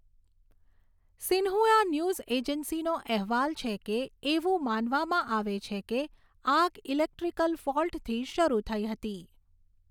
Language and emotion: Gujarati, neutral